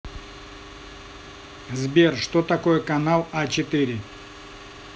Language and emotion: Russian, neutral